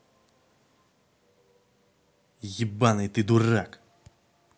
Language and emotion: Russian, angry